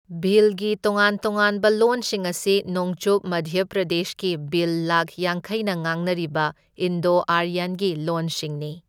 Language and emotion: Manipuri, neutral